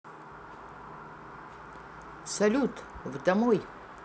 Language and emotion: Russian, positive